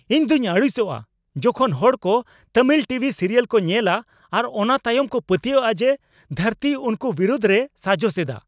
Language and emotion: Santali, angry